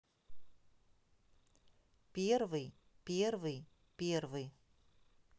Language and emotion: Russian, neutral